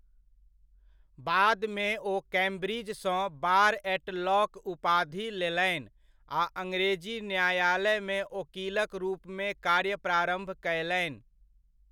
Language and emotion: Maithili, neutral